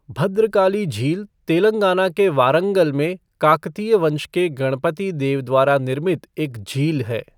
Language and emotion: Hindi, neutral